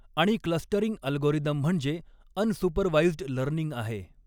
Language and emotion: Marathi, neutral